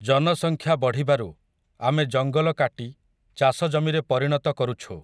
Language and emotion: Odia, neutral